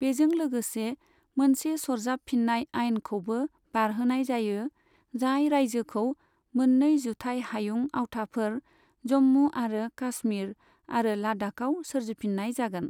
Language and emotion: Bodo, neutral